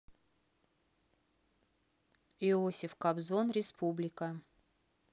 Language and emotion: Russian, neutral